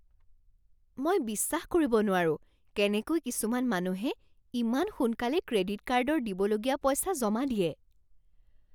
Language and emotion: Assamese, surprised